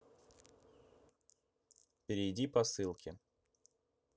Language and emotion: Russian, neutral